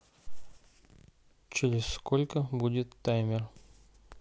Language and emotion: Russian, neutral